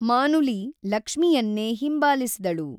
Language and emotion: Kannada, neutral